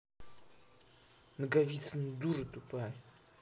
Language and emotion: Russian, angry